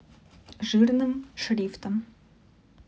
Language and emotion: Russian, neutral